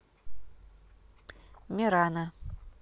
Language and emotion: Russian, neutral